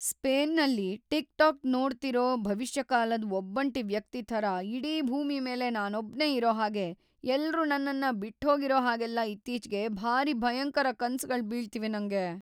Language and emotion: Kannada, fearful